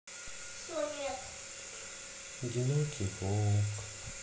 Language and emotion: Russian, sad